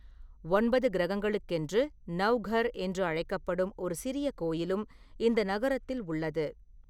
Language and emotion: Tamil, neutral